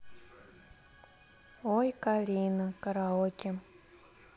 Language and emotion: Russian, neutral